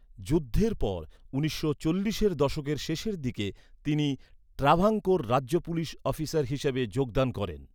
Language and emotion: Bengali, neutral